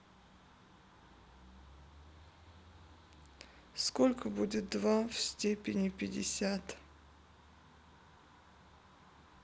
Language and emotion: Russian, sad